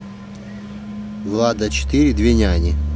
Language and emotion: Russian, neutral